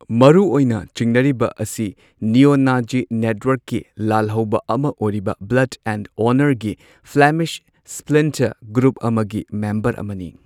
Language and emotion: Manipuri, neutral